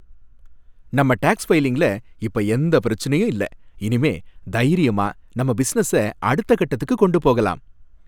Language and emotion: Tamil, happy